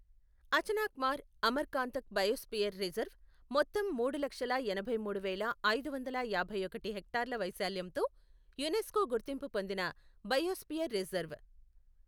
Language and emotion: Telugu, neutral